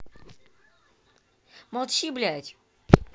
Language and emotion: Russian, angry